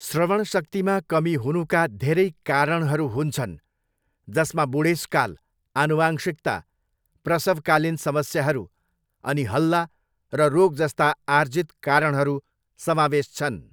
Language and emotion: Nepali, neutral